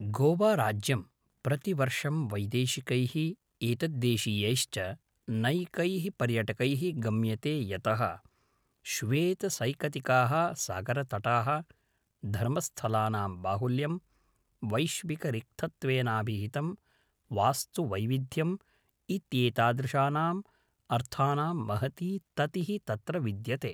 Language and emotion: Sanskrit, neutral